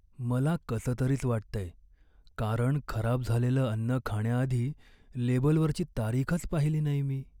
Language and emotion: Marathi, sad